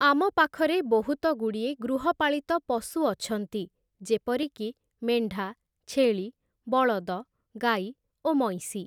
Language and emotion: Odia, neutral